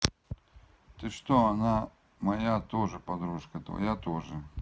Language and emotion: Russian, neutral